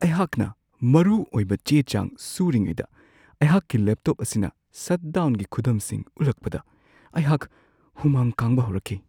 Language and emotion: Manipuri, fearful